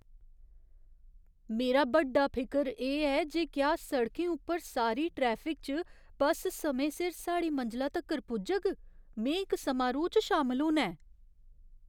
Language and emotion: Dogri, fearful